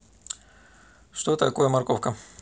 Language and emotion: Russian, neutral